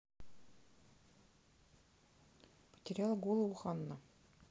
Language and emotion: Russian, neutral